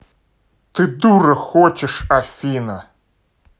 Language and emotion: Russian, angry